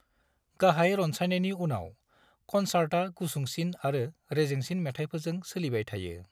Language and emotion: Bodo, neutral